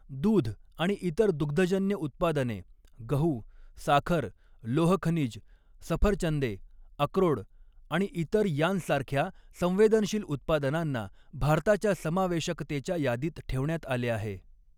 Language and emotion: Marathi, neutral